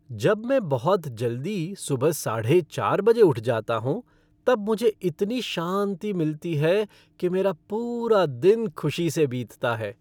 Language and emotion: Hindi, happy